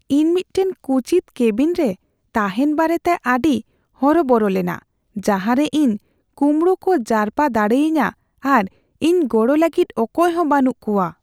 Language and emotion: Santali, fearful